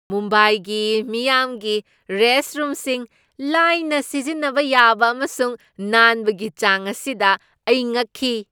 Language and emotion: Manipuri, surprised